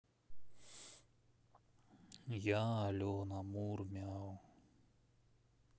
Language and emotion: Russian, sad